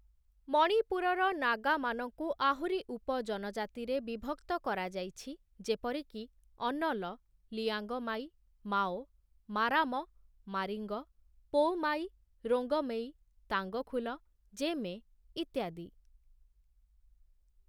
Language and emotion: Odia, neutral